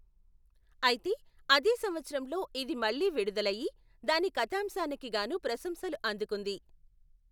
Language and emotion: Telugu, neutral